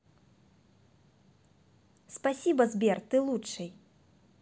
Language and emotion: Russian, positive